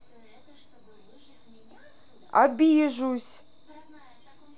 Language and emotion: Russian, neutral